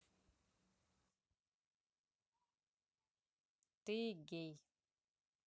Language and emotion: Russian, positive